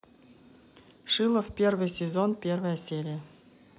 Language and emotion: Russian, neutral